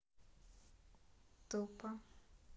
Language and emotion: Russian, neutral